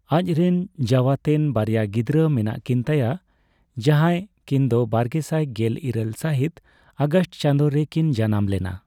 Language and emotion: Santali, neutral